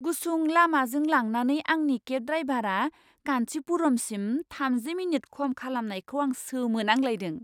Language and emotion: Bodo, surprised